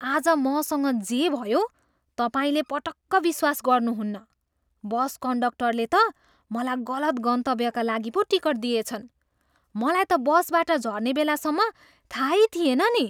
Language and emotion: Nepali, surprised